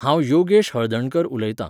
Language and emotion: Goan Konkani, neutral